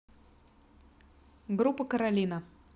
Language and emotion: Russian, neutral